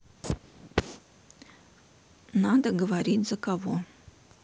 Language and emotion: Russian, neutral